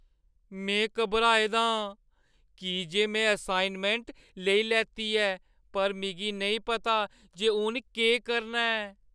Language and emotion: Dogri, fearful